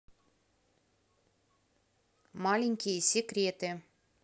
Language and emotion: Russian, neutral